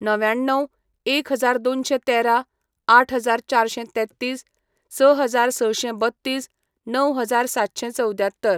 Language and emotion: Goan Konkani, neutral